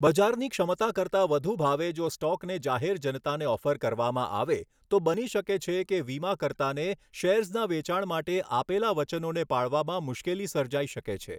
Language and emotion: Gujarati, neutral